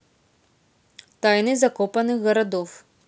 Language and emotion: Russian, neutral